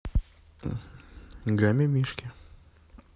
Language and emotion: Russian, neutral